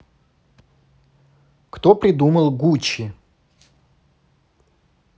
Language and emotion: Russian, neutral